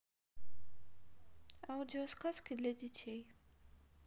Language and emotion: Russian, neutral